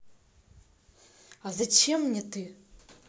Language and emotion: Russian, neutral